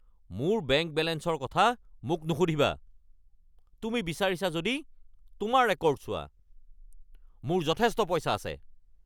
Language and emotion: Assamese, angry